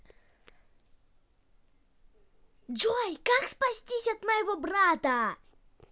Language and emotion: Russian, angry